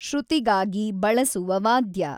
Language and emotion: Kannada, neutral